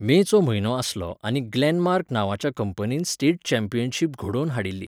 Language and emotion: Goan Konkani, neutral